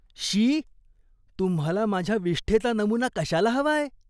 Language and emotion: Marathi, disgusted